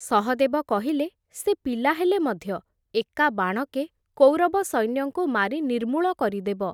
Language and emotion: Odia, neutral